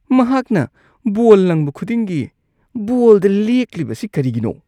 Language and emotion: Manipuri, disgusted